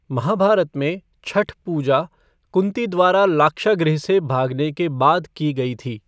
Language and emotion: Hindi, neutral